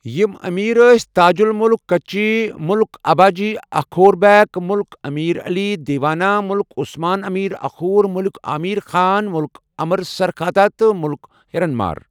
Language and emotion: Kashmiri, neutral